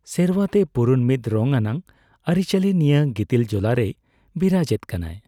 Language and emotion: Santali, neutral